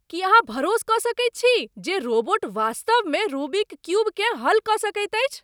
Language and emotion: Maithili, surprised